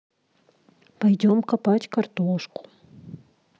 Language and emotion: Russian, sad